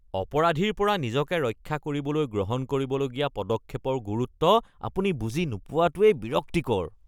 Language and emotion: Assamese, disgusted